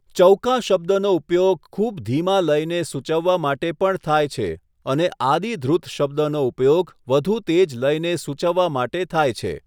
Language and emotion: Gujarati, neutral